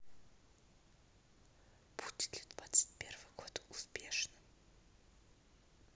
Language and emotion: Russian, neutral